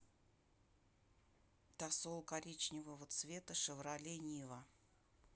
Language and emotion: Russian, neutral